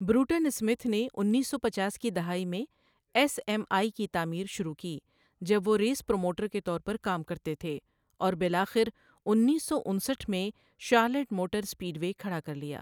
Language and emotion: Urdu, neutral